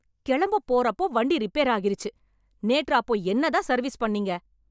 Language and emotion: Tamil, angry